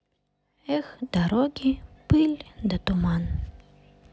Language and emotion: Russian, sad